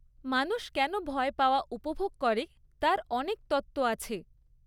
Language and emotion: Bengali, neutral